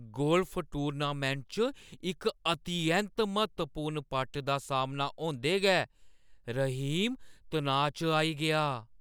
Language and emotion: Dogri, fearful